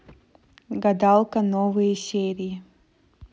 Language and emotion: Russian, neutral